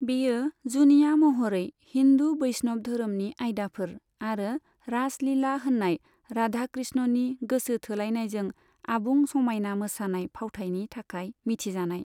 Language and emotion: Bodo, neutral